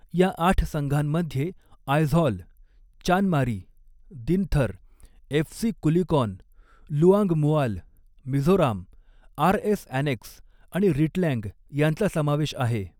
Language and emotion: Marathi, neutral